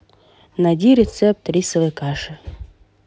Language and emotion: Russian, neutral